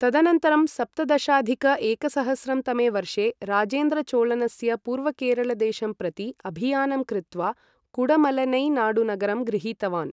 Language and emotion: Sanskrit, neutral